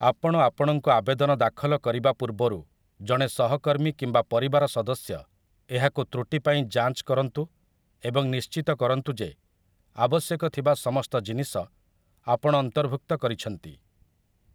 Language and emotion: Odia, neutral